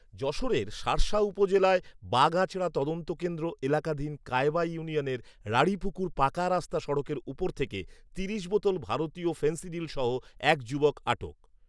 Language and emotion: Bengali, neutral